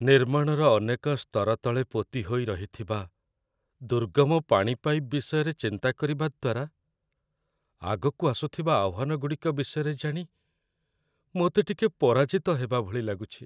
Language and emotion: Odia, sad